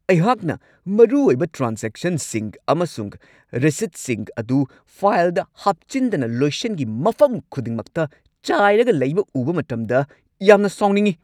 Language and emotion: Manipuri, angry